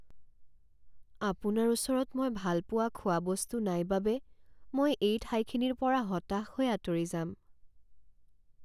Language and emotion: Assamese, sad